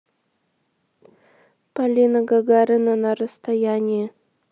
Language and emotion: Russian, neutral